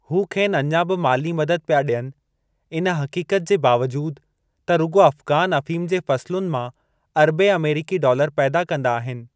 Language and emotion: Sindhi, neutral